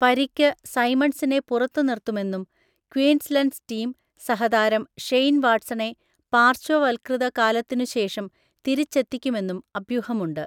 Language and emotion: Malayalam, neutral